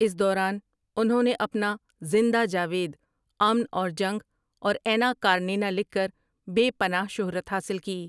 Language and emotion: Urdu, neutral